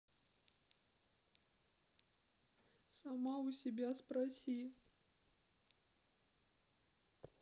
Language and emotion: Russian, sad